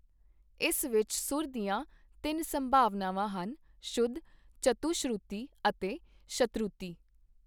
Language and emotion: Punjabi, neutral